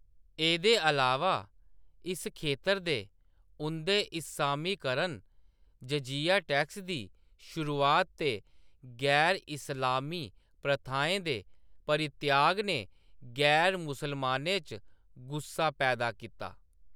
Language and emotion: Dogri, neutral